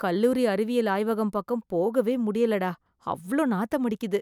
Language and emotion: Tamil, disgusted